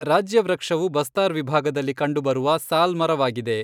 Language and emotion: Kannada, neutral